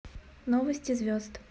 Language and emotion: Russian, neutral